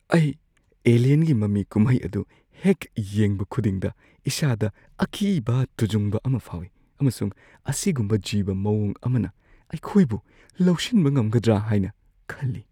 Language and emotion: Manipuri, fearful